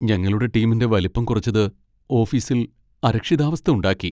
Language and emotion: Malayalam, sad